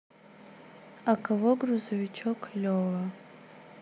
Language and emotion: Russian, neutral